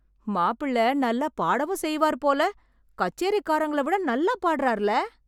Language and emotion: Tamil, surprised